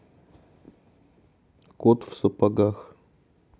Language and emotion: Russian, neutral